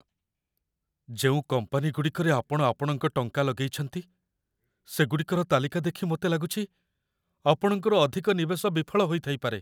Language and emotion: Odia, fearful